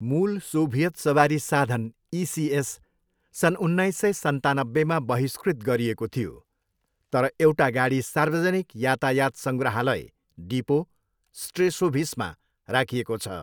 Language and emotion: Nepali, neutral